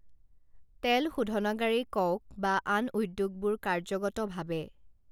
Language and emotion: Assamese, neutral